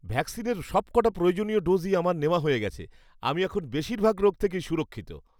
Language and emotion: Bengali, happy